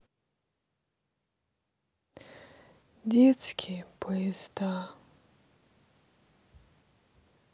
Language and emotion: Russian, sad